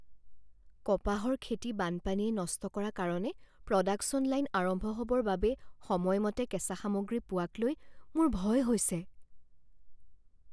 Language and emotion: Assamese, fearful